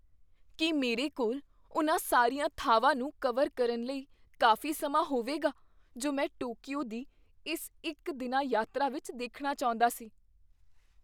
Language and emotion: Punjabi, fearful